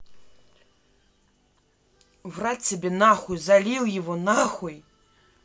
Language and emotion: Russian, angry